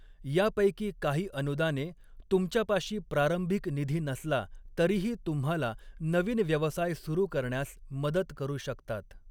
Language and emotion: Marathi, neutral